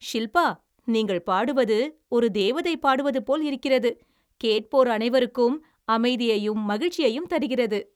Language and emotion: Tamil, happy